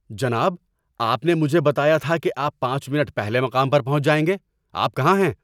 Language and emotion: Urdu, angry